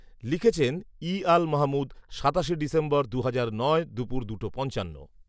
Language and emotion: Bengali, neutral